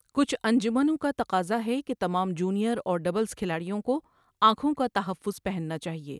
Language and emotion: Urdu, neutral